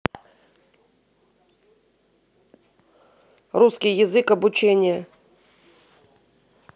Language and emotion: Russian, neutral